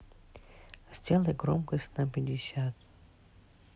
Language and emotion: Russian, neutral